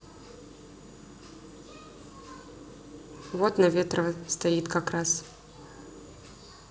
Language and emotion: Russian, neutral